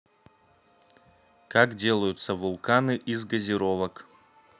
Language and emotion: Russian, neutral